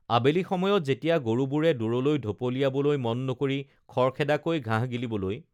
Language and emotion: Assamese, neutral